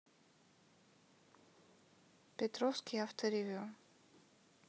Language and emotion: Russian, neutral